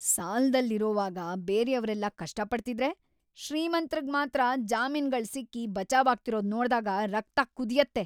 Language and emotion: Kannada, angry